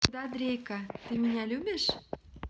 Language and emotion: Russian, positive